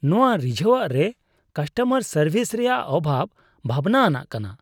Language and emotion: Santali, disgusted